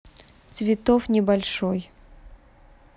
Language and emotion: Russian, neutral